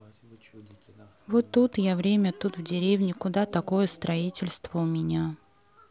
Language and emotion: Russian, neutral